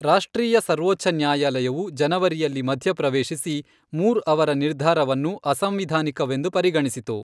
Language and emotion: Kannada, neutral